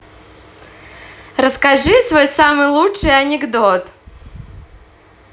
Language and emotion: Russian, positive